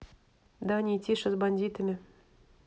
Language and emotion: Russian, neutral